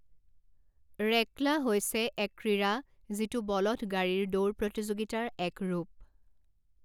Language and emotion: Assamese, neutral